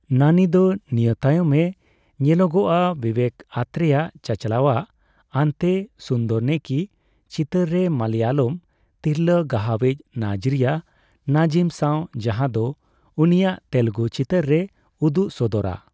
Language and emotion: Santali, neutral